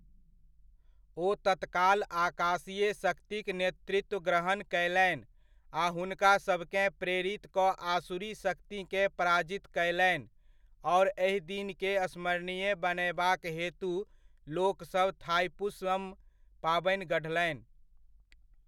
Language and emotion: Maithili, neutral